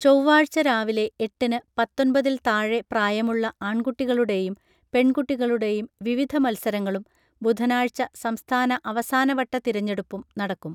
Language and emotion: Malayalam, neutral